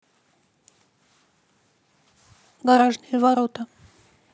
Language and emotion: Russian, neutral